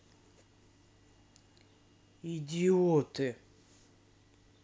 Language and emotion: Russian, angry